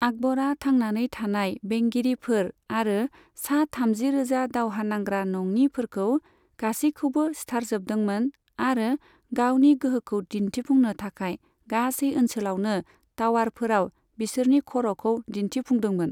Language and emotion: Bodo, neutral